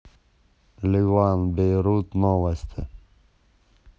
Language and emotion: Russian, neutral